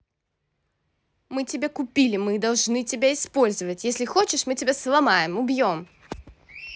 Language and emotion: Russian, angry